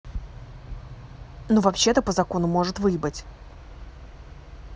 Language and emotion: Russian, angry